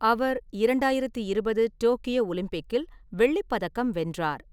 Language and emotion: Tamil, neutral